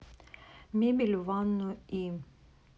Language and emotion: Russian, neutral